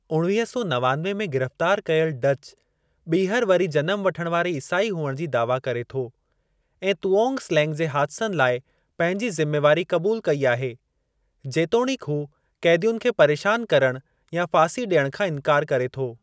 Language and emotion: Sindhi, neutral